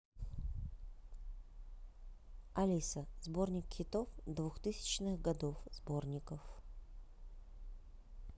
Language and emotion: Russian, neutral